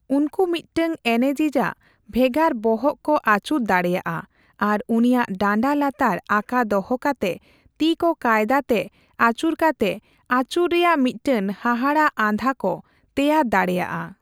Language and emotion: Santali, neutral